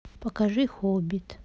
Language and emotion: Russian, neutral